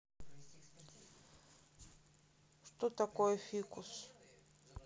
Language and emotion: Russian, neutral